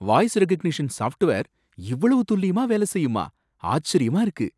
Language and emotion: Tamil, surprised